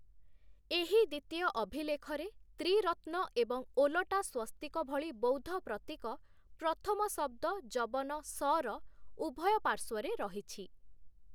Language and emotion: Odia, neutral